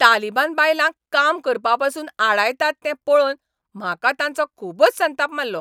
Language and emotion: Goan Konkani, angry